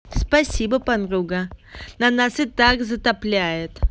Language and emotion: Russian, angry